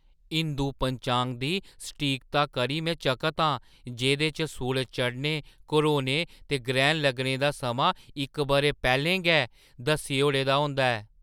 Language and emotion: Dogri, surprised